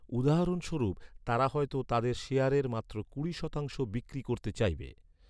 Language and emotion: Bengali, neutral